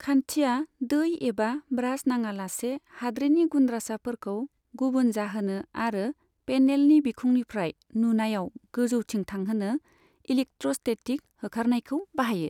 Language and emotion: Bodo, neutral